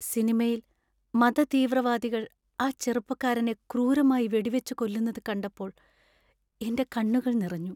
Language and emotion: Malayalam, sad